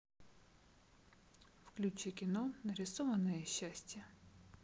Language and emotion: Russian, neutral